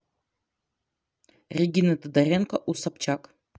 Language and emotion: Russian, neutral